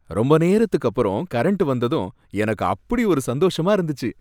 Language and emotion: Tamil, happy